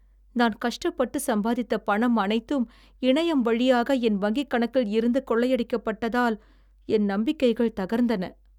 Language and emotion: Tamil, sad